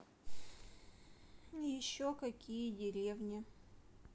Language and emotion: Russian, neutral